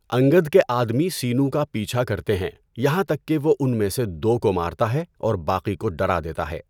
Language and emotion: Urdu, neutral